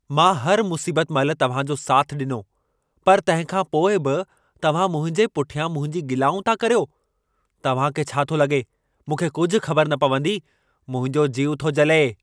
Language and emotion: Sindhi, angry